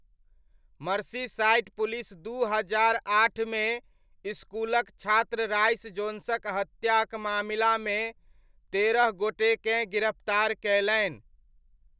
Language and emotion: Maithili, neutral